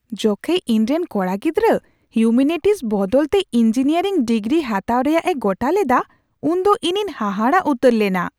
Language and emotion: Santali, surprised